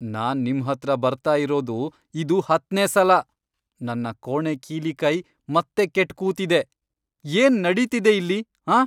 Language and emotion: Kannada, angry